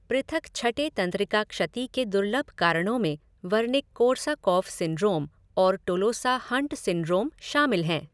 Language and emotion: Hindi, neutral